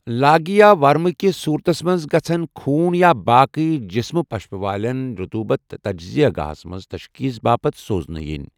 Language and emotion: Kashmiri, neutral